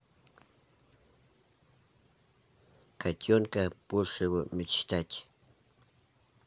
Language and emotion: Russian, neutral